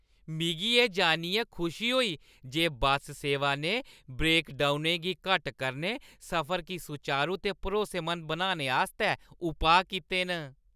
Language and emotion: Dogri, happy